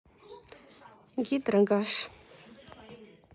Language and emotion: Russian, neutral